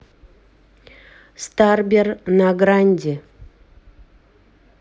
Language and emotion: Russian, neutral